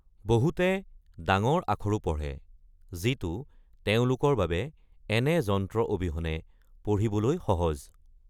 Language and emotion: Assamese, neutral